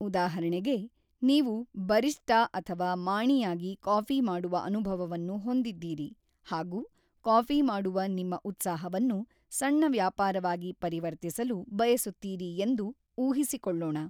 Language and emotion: Kannada, neutral